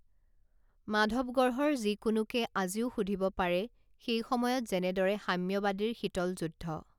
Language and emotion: Assamese, neutral